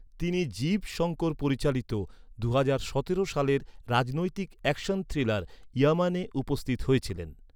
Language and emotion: Bengali, neutral